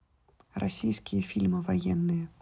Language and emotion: Russian, neutral